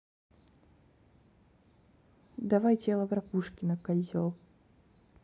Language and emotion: Russian, neutral